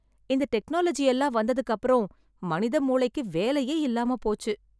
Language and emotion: Tamil, sad